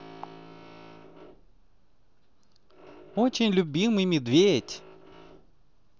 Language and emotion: Russian, positive